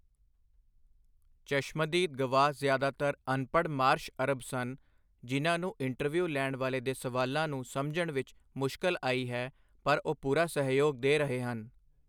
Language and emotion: Punjabi, neutral